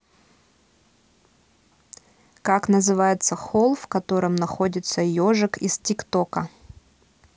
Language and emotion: Russian, neutral